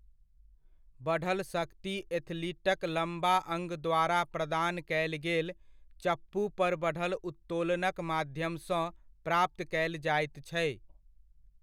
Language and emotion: Maithili, neutral